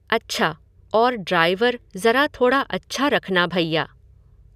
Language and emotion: Hindi, neutral